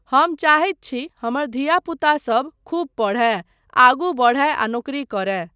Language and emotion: Maithili, neutral